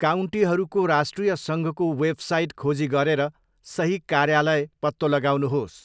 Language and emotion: Nepali, neutral